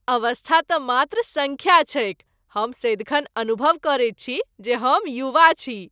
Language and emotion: Maithili, happy